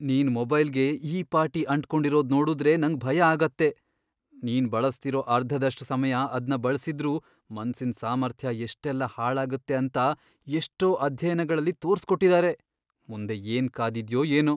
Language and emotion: Kannada, fearful